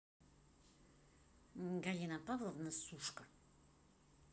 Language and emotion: Russian, neutral